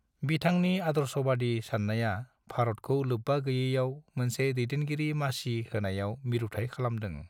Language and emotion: Bodo, neutral